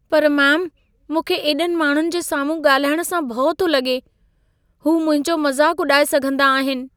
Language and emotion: Sindhi, fearful